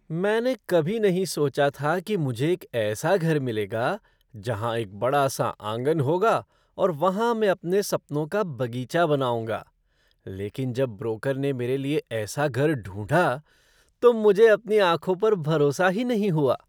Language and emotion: Hindi, surprised